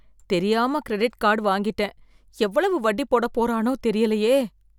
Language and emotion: Tamil, fearful